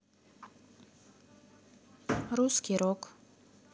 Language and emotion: Russian, neutral